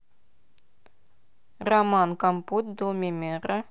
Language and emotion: Russian, neutral